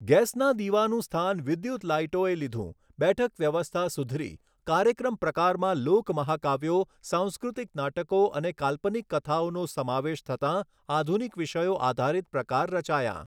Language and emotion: Gujarati, neutral